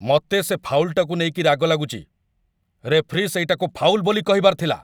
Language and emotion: Odia, angry